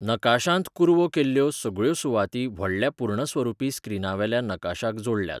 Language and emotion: Goan Konkani, neutral